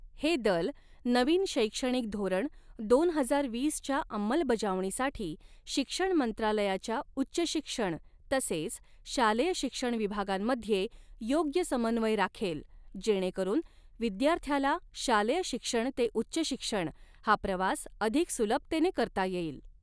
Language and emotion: Marathi, neutral